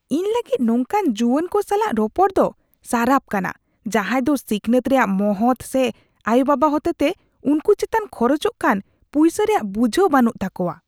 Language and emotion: Santali, disgusted